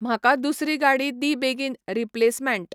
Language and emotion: Goan Konkani, neutral